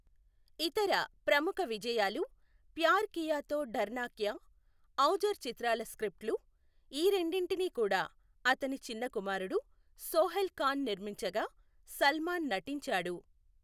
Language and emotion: Telugu, neutral